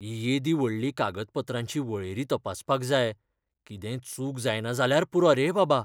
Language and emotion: Goan Konkani, fearful